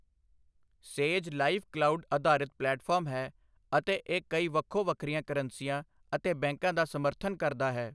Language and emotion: Punjabi, neutral